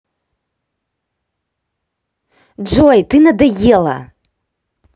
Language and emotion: Russian, angry